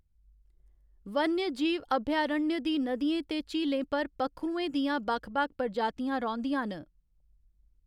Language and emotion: Dogri, neutral